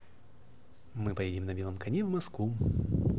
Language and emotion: Russian, positive